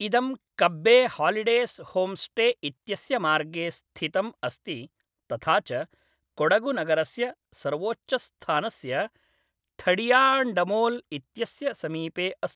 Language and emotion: Sanskrit, neutral